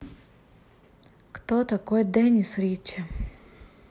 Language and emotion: Russian, neutral